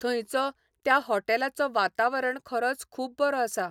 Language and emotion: Goan Konkani, neutral